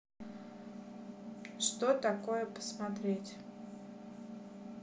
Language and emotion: Russian, neutral